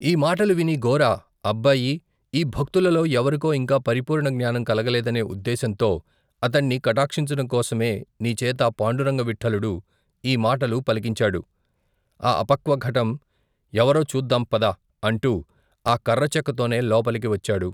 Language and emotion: Telugu, neutral